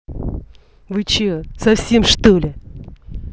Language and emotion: Russian, angry